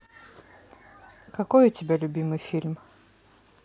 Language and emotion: Russian, neutral